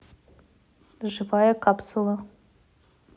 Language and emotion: Russian, neutral